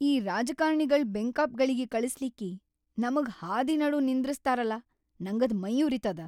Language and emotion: Kannada, angry